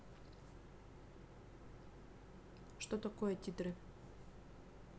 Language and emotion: Russian, neutral